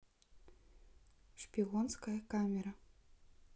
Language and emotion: Russian, neutral